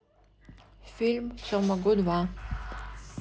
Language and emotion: Russian, neutral